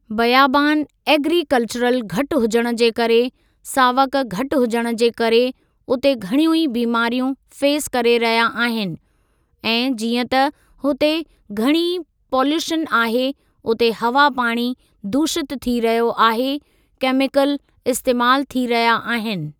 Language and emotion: Sindhi, neutral